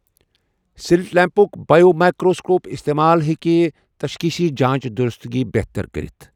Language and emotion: Kashmiri, neutral